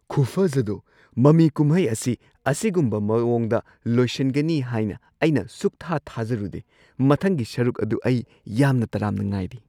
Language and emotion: Manipuri, surprised